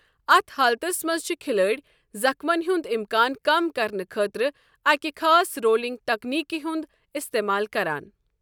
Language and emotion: Kashmiri, neutral